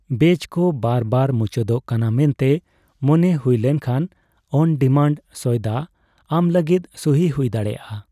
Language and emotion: Santali, neutral